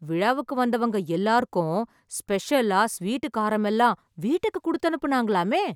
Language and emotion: Tamil, surprised